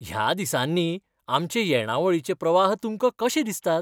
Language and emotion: Goan Konkani, happy